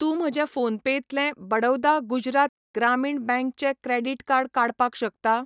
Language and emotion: Goan Konkani, neutral